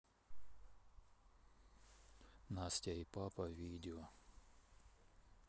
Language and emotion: Russian, neutral